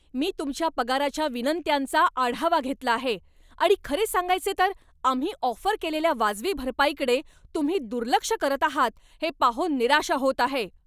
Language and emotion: Marathi, angry